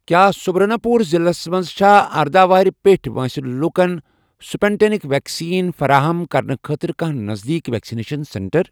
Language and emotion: Kashmiri, neutral